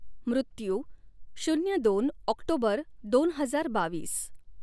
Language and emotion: Marathi, neutral